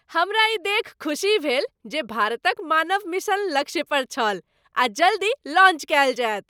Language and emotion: Maithili, happy